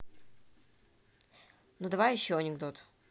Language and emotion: Russian, neutral